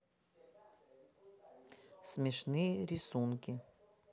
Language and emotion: Russian, neutral